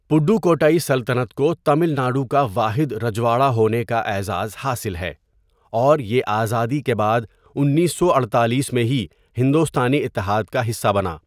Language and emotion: Urdu, neutral